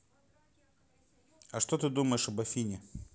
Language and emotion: Russian, neutral